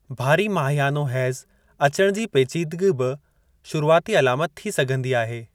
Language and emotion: Sindhi, neutral